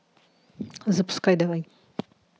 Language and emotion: Russian, neutral